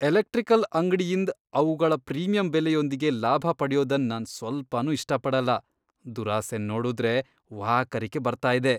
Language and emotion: Kannada, disgusted